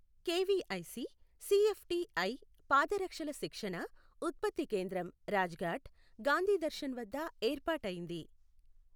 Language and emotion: Telugu, neutral